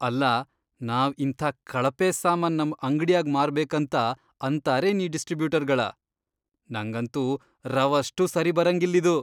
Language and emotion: Kannada, disgusted